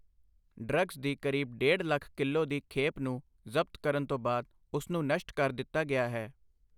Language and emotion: Punjabi, neutral